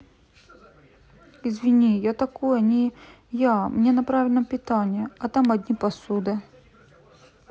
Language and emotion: Russian, sad